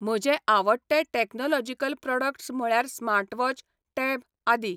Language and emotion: Goan Konkani, neutral